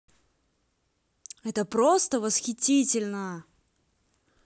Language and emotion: Russian, positive